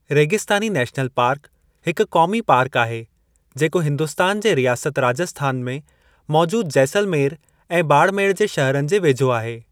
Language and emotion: Sindhi, neutral